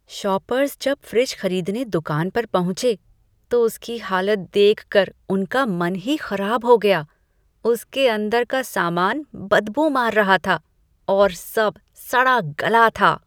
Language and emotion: Hindi, disgusted